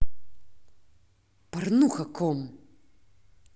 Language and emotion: Russian, angry